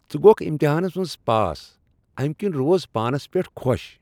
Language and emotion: Kashmiri, happy